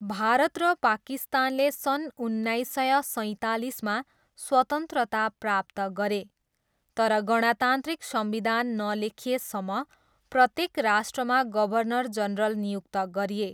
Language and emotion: Nepali, neutral